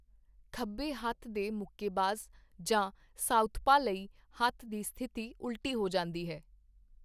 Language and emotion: Punjabi, neutral